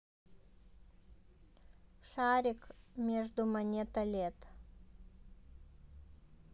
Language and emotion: Russian, neutral